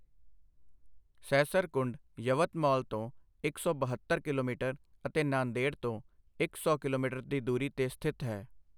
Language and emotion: Punjabi, neutral